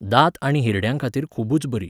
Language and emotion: Goan Konkani, neutral